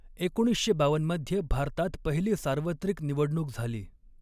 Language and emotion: Marathi, neutral